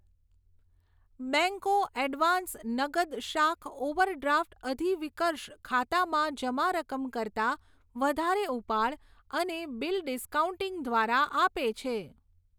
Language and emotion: Gujarati, neutral